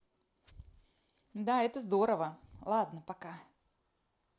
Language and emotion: Russian, positive